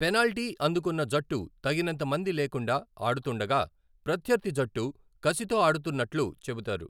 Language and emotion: Telugu, neutral